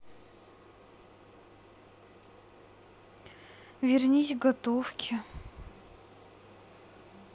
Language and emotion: Russian, sad